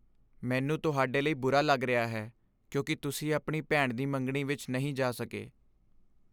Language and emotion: Punjabi, sad